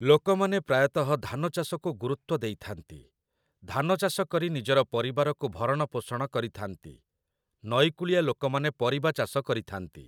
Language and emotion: Odia, neutral